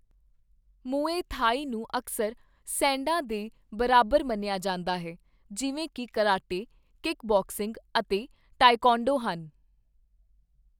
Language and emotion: Punjabi, neutral